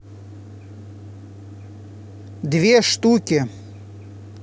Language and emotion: Russian, angry